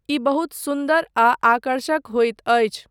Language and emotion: Maithili, neutral